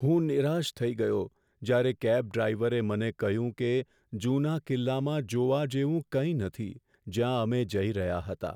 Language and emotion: Gujarati, sad